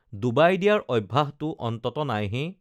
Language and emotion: Assamese, neutral